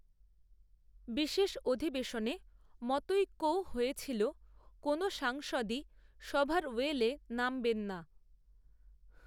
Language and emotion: Bengali, neutral